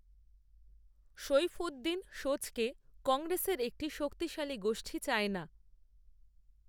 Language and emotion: Bengali, neutral